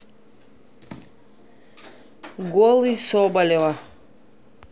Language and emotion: Russian, neutral